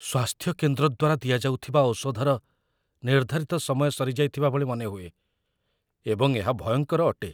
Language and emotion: Odia, fearful